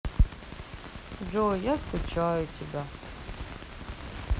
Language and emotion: Russian, sad